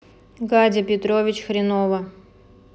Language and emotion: Russian, neutral